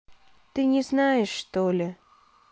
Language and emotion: Russian, sad